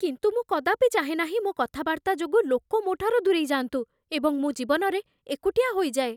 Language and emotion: Odia, fearful